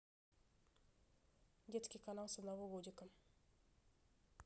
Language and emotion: Russian, neutral